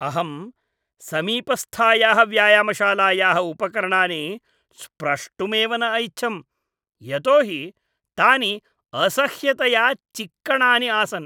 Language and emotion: Sanskrit, disgusted